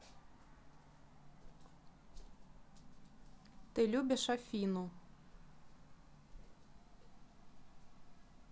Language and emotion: Russian, neutral